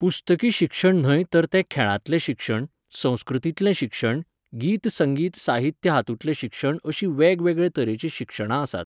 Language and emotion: Goan Konkani, neutral